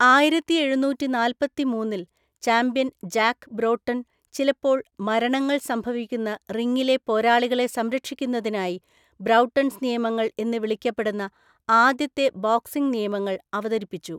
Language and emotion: Malayalam, neutral